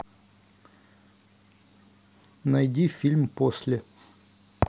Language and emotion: Russian, neutral